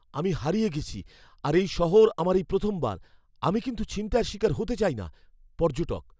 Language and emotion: Bengali, fearful